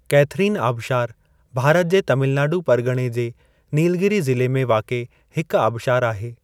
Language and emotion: Sindhi, neutral